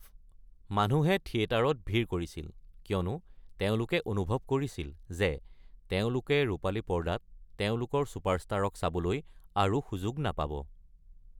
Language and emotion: Assamese, neutral